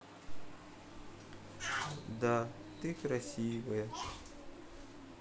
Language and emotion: Russian, sad